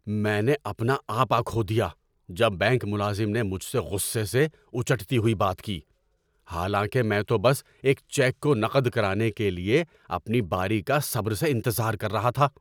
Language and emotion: Urdu, angry